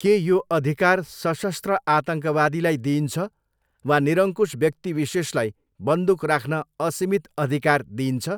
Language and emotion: Nepali, neutral